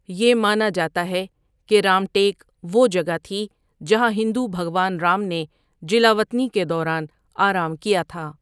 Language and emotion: Urdu, neutral